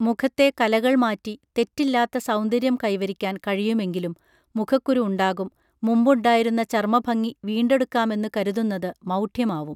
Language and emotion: Malayalam, neutral